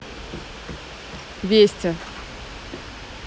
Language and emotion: Russian, neutral